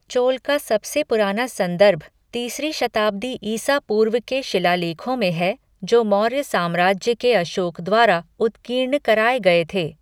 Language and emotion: Hindi, neutral